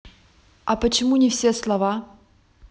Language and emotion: Russian, neutral